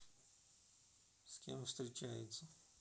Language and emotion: Russian, neutral